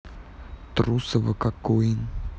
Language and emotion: Russian, neutral